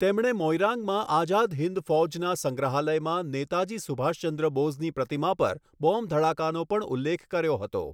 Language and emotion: Gujarati, neutral